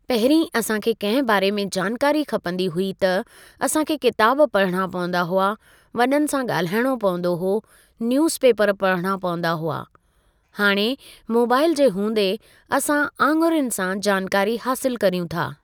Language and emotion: Sindhi, neutral